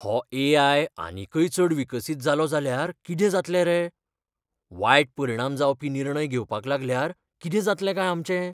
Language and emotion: Goan Konkani, fearful